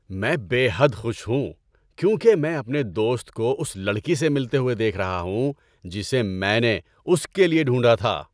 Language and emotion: Urdu, happy